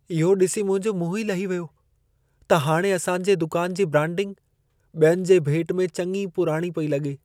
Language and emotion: Sindhi, sad